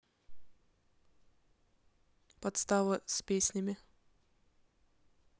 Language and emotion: Russian, neutral